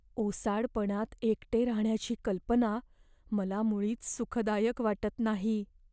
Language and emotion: Marathi, fearful